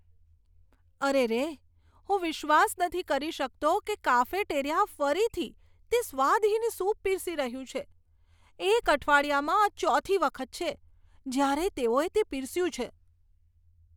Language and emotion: Gujarati, disgusted